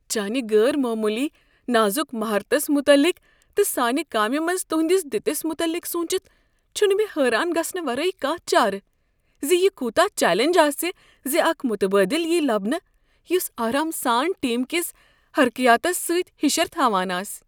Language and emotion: Kashmiri, fearful